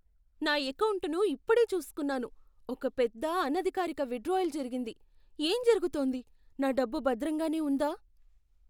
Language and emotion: Telugu, fearful